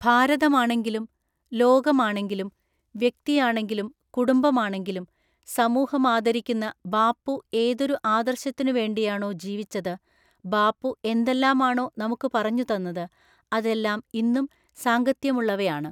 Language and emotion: Malayalam, neutral